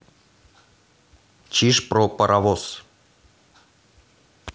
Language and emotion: Russian, neutral